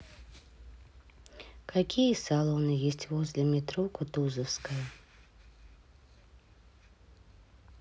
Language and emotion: Russian, sad